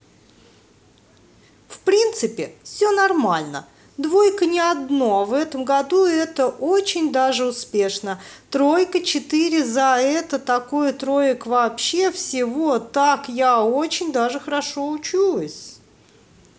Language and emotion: Russian, angry